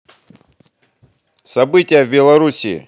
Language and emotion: Russian, positive